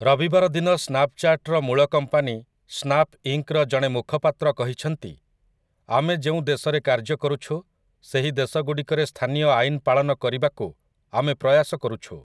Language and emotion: Odia, neutral